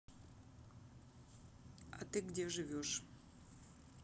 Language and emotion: Russian, neutral